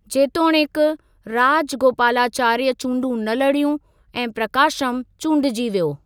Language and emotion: Sindhi, neutral